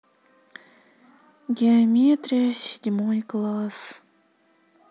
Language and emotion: Russian, sad